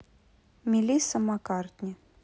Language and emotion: Russian, neutral